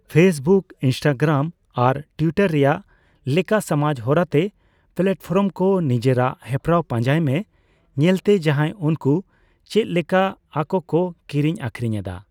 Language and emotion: Santali, neutral